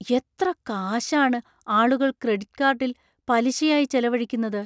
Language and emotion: Malayalam, surprised